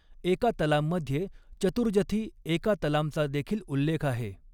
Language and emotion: Marathi, neutral